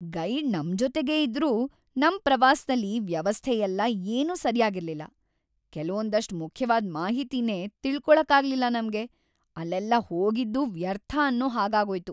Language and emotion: Kannada, sad